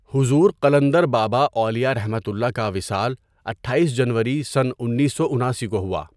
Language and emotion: Urdu, neutral